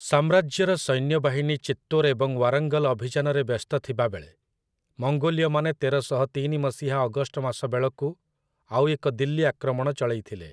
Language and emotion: Odia, neutral